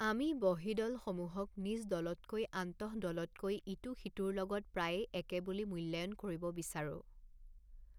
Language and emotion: Assamese, neutral